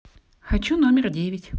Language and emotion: Russian, positive